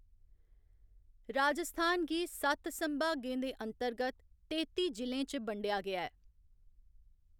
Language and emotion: Dogri, neutral